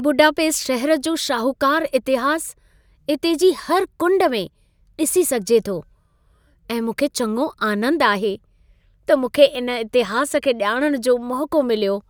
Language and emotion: Sindhi, happy